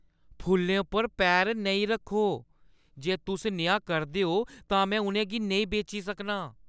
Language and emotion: Dogri, angry